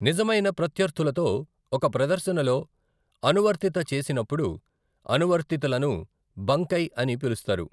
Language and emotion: Telugu, neutral